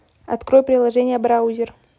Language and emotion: Russian, neutral